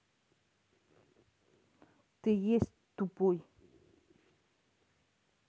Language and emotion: Russian, neutral